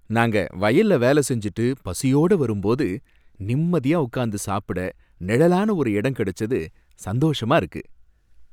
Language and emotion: Tamil, happy